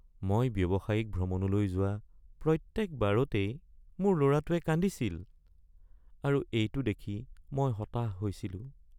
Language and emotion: Assamese, sad